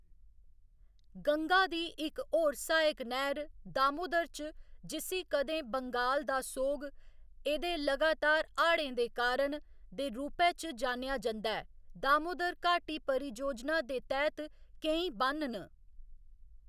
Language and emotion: Dogri, neutral